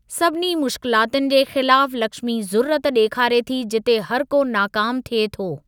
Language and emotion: Sindhi, neutral